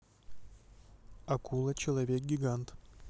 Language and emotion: Russian, neutral